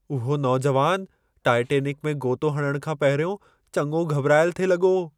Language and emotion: Sindhi, fearful